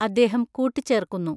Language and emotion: Malayalam, neutral